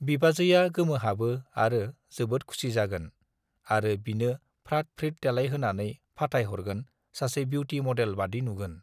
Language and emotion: Bodo, neutral